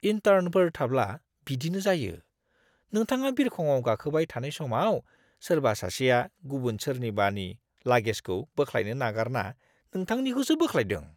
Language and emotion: Bodo, disgusted